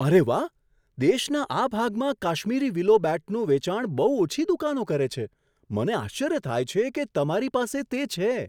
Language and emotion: Gujarati, surprised